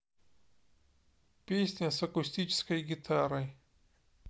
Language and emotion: Russian, neutral